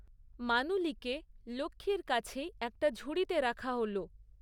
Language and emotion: Bengali, neutral